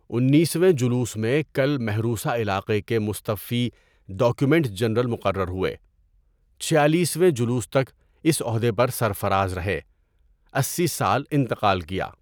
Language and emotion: Urdu, neutral